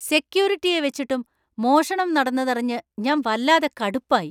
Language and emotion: Malayalam, angry